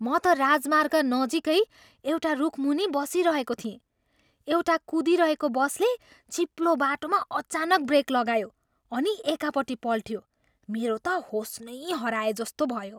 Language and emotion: Nepali, surprised